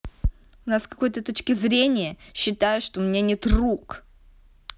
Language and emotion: Russian, angry